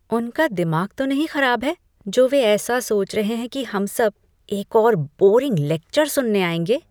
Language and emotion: Hindi, disgusted